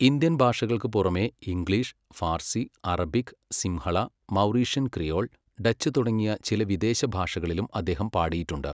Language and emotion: Malayalam, neutral